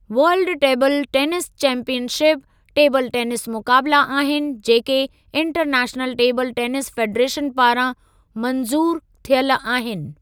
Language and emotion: Sindhi, neutral